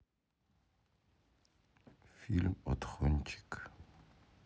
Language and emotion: Russian, neutral